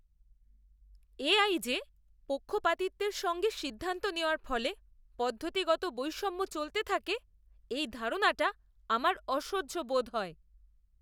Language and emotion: Bengali, disgusted